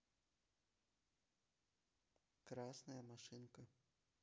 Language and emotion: Russian, neutral